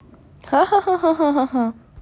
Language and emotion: Russian, neutral